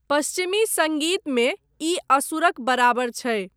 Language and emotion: Maithili, neutral